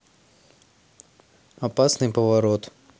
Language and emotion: Russian, neutral